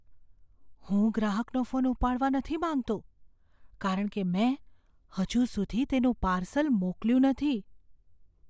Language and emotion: Gujarati, fearful